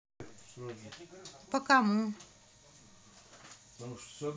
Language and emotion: Russian, neutral